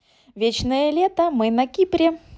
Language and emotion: Russian, positive